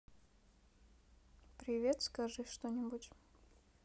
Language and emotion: Russian, neutral